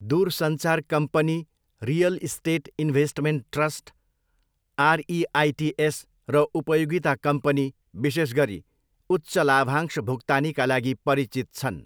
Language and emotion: Nepali, neutral